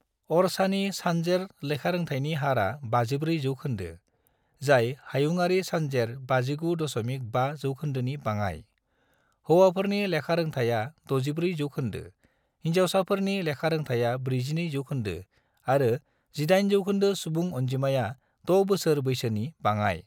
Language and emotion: Bodo, neutral